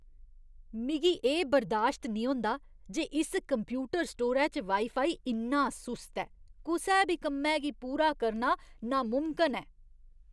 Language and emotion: Dogri, disgusted